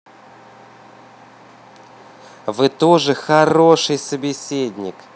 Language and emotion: Russian, positive